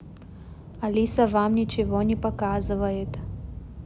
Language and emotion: Russian, neutral